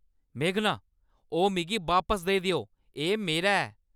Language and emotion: Dogri, angry